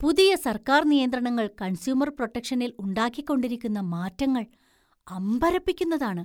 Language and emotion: Malayalam, surprised